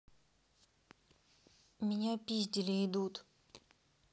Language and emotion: Russian, neutral